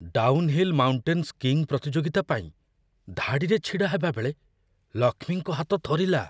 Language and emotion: Odia, fearful